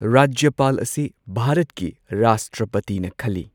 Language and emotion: Manipuri, neutral